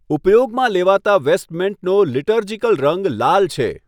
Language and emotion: Gujarati, neutral